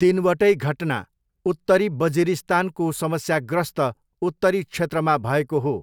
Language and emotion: Nepali, neutral